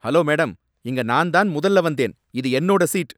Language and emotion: Tamil, angry